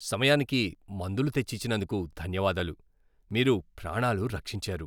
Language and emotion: Telugu, happy